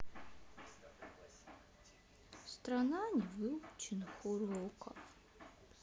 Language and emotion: Russian, sad